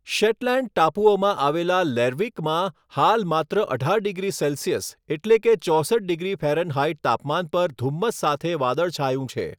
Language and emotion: Gujarati, neutral